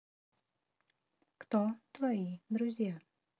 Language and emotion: Russian, neutral